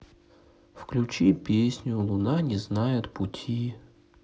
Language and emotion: Russian, sad